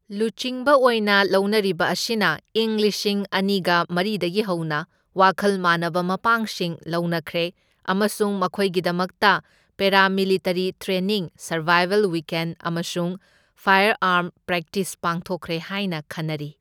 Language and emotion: Manipuri, neutral